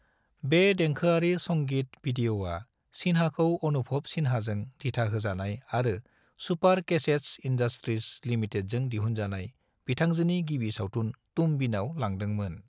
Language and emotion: Bodo, neutral